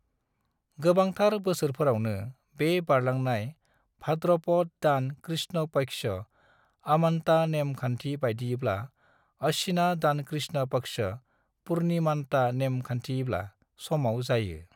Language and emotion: Bodo, neutral